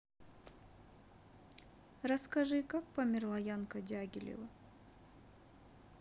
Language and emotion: Russian, sad